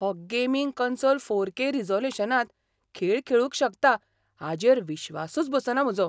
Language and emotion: Goan Konkani, surprised